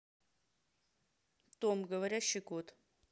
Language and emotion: Russian, neutral